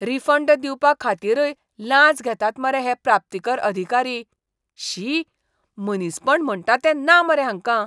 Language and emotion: Goan Konkani, disgusted